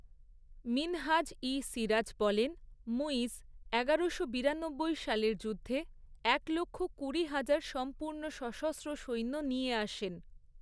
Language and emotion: Bengali, neutral